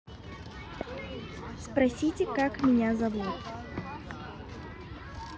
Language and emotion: Russian, neutral